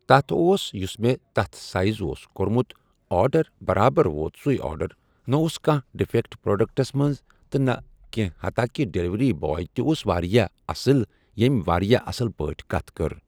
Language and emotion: Kashmiri, neutral